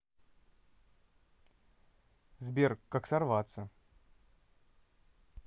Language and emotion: Russian, neutral